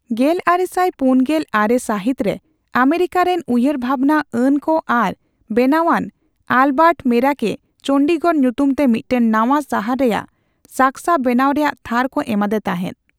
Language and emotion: Santali, neutral